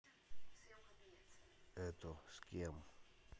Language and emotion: Russian, neutral